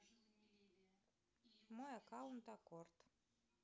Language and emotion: Russian, neutral